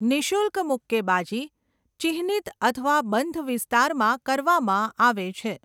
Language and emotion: Gujarati, neutral